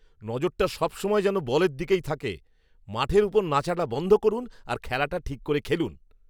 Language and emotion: Bengali, angry